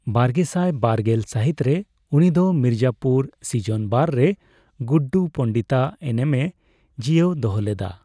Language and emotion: Santali, neutral